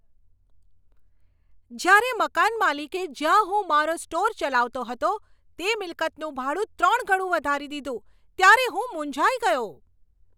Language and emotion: Gujarati, angry